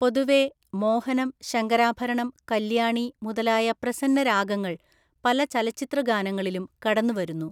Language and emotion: Malayalam, neutral